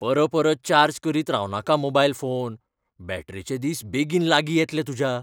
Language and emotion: Goan Konkani, fearful